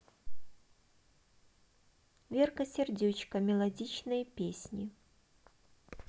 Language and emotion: Russian, neutral